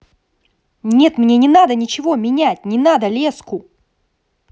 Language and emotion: Russian, angry